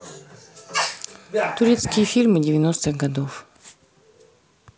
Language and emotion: Russian, neutral